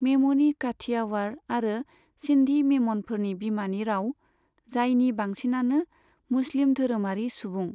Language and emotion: Bodo, neutral